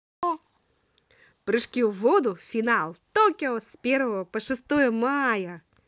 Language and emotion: Russian, positive